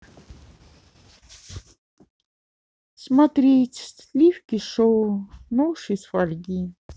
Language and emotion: Russian, sad